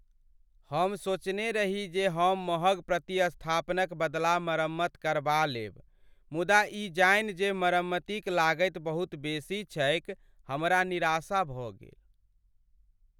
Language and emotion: Maithili, sad